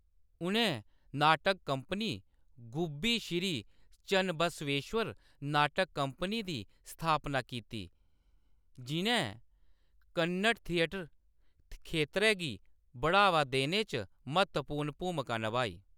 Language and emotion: Dogri, neutral